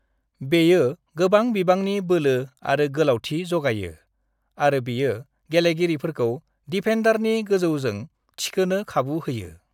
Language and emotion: Bodo, neutral